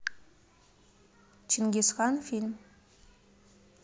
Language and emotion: Russian, neutral